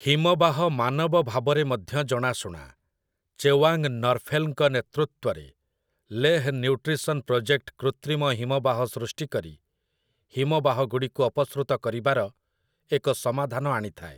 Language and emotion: Odia, neutral